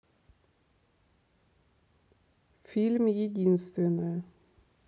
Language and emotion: Russian, neutral